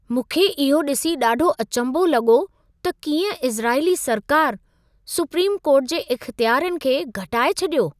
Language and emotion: Sindhi, surprised